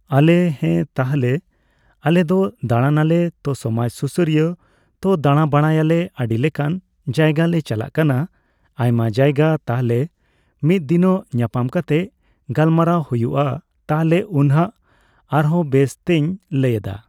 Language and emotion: Santali, neutral